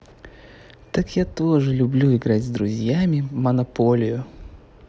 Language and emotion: Russian, positive